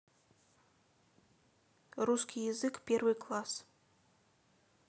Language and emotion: Russian, neutral